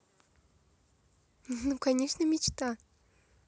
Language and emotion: Russian, positive